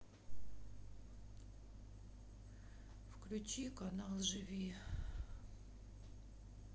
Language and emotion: Russian, sad